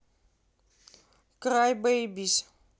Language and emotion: Russian, neutral